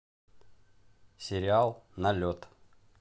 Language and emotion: Russian, neutral